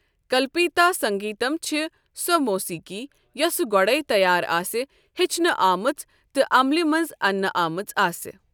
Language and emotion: Kashmiri, neutral